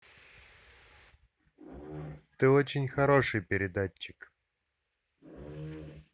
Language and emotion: Russian, neutral